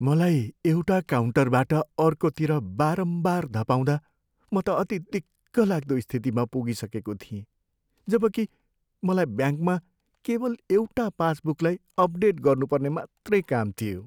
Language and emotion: Nepali, sad